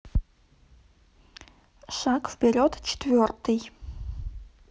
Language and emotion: Russian, neutral